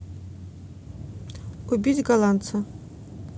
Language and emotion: Russian, neutral